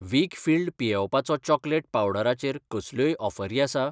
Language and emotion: Goan Konkani, neutral